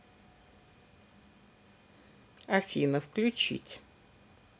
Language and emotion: Russian, neutral